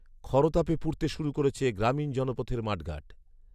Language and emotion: Bengali, neutral